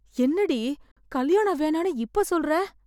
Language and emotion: Tamil, fearful